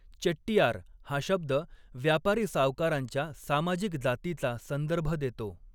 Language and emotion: Marathi, neutral